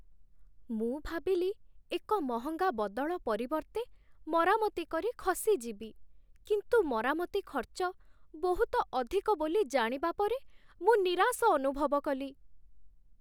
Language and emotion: Odia, sad